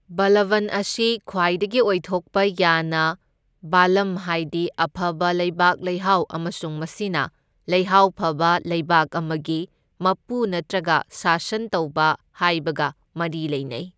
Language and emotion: Manipuri, neutral